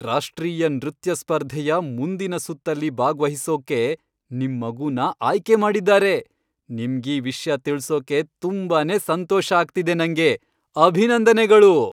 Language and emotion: Kannada, happy